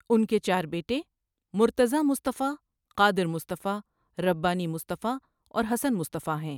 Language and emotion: Urdu, neutral